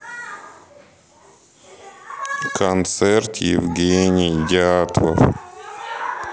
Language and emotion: Russian, sad